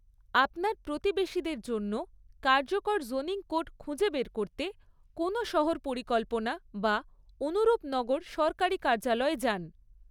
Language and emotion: Bengali, neutral